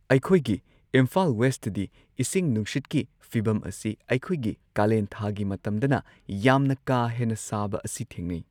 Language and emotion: Manipuri, neutral